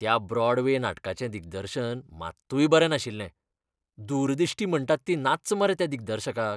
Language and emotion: Goan Konkani, disgusted